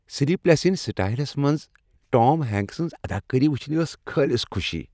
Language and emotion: Kashmiri, happy